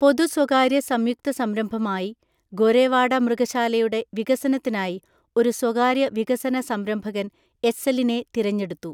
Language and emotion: Malayalam, neutral